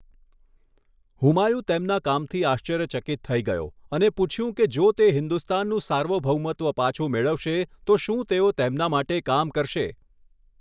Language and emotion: Gujarati, neutral